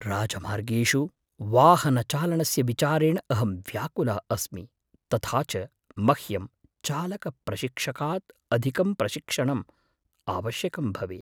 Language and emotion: Sanskrit, fearful